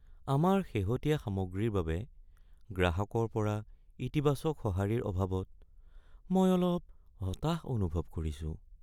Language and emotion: Assamese, sad